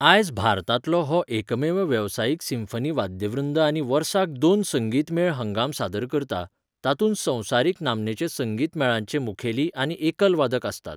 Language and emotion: Goan Konkani, neutral